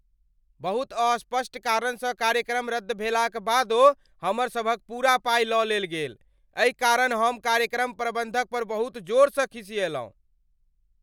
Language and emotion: Maithili, angry